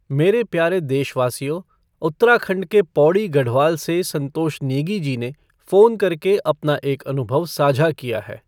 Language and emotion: Hindi, neutral